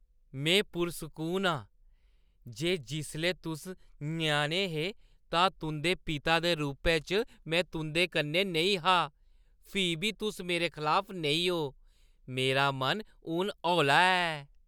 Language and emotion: Dogri, happy